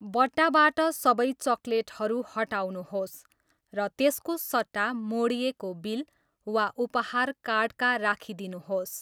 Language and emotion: Nepali, neutral